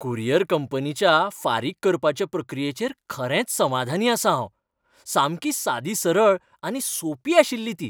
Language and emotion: Goan Konkani, happy